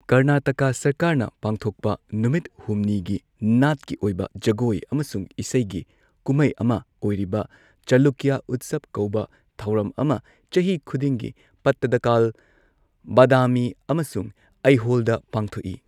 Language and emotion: Manipuri, neutral